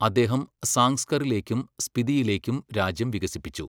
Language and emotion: Malayalam, neutral